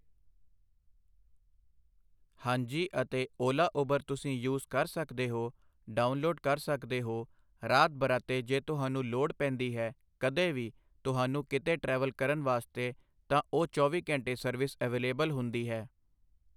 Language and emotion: Punjabi, neutral